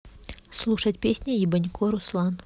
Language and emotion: Russian, neutral